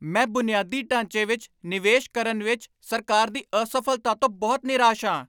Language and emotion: Punjabi, angry